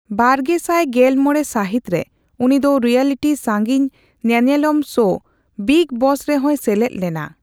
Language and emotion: Santali, neutral